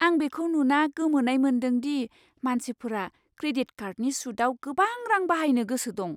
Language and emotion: Bodo, surprised